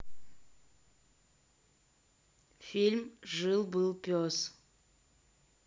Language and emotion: Russian, neutral